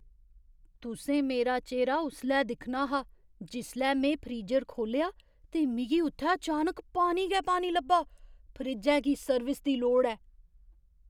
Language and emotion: Dogri, surprised